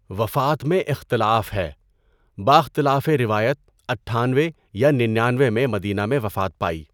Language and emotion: Urdu, neutral